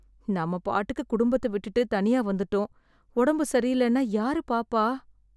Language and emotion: Tamil, sad